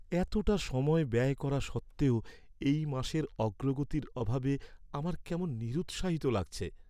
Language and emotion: Bengali, sad